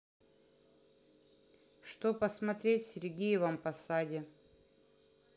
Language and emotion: Russian, neutral